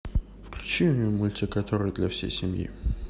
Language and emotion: Russian, neutral